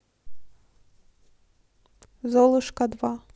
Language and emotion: Russian, neutral